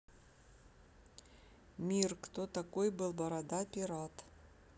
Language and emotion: Russian, neutral